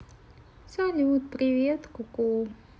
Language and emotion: Russian, neutral